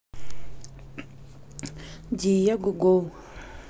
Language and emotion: Russian, neutral